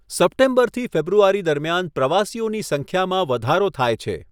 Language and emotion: Gujarati, neutral